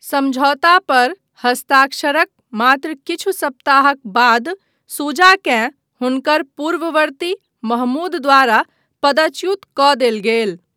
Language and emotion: Maithili, neutral